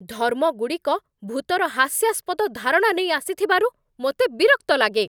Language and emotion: Odia, angry